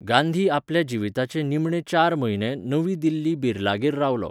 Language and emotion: Goan Konkani, neutral